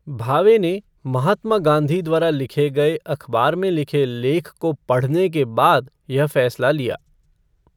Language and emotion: Hindi, neutral